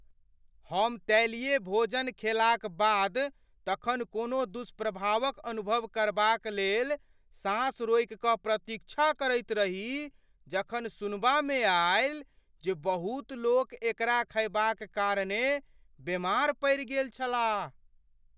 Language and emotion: Maithili, fearful